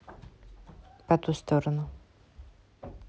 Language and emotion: Russian, neutral